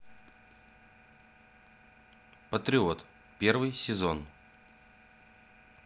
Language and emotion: Russian, neutral